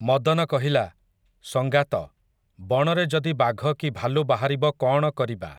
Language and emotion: Odia, neutral